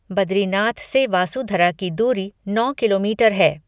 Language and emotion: Hindi, neutral